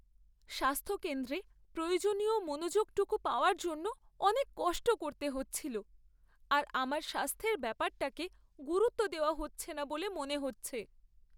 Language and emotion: Bengali, sad